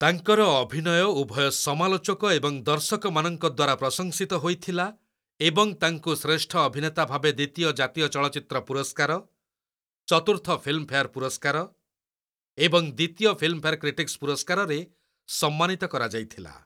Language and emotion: Odia, neutral